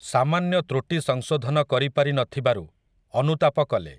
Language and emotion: Odia, neutral